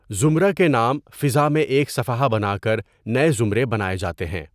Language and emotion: Urdu, neutral